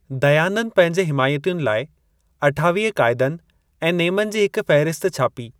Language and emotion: Sindhi, neutral